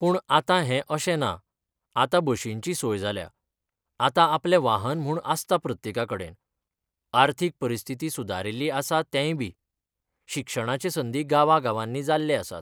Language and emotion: Goan Konkani, neutral